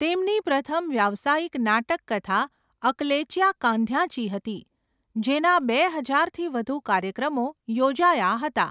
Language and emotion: Gujarati, neutral